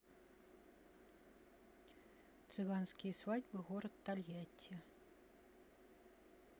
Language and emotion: Russian, neutral